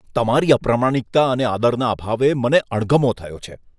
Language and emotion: Gujarati, disgusted